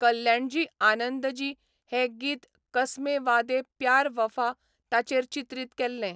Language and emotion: Goan Konkani, neutral